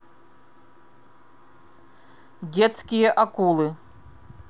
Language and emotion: Russian, neutral